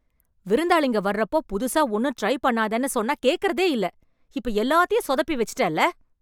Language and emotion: Tamil, angry